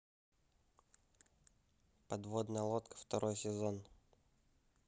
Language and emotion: Russian, neutral